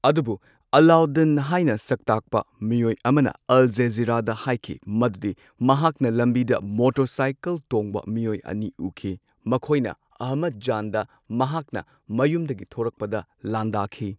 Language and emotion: Manipuri, neutral